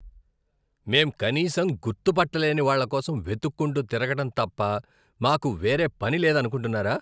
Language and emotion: Telugu, disgusted